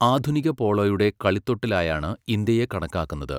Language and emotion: Malayalam, neutral